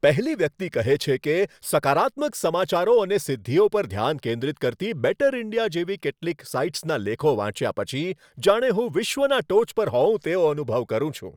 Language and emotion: Gujarati, happy